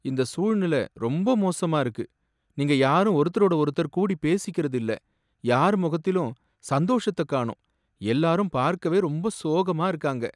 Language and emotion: Tamil, sad